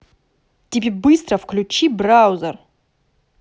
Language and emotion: Russian, angry